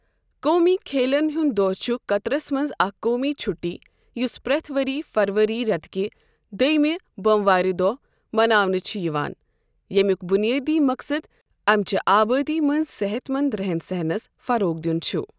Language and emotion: Kashmiri, neutral